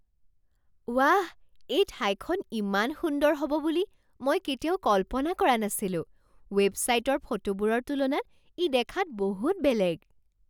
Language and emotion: Assamese, surprised